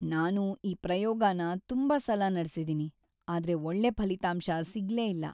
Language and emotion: Kannada, sad